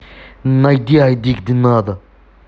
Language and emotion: Russian, angry